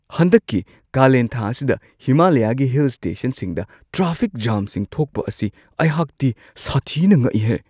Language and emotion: Manipuri, surprised